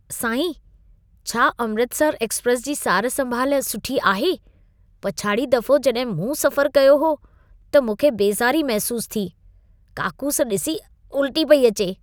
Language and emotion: Sindhi, disgusted